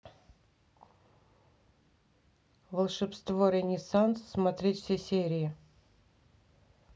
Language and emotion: Russian, neutral